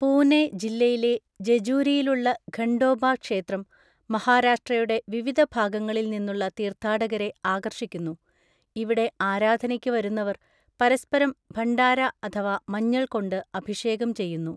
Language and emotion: Malayalam, neutral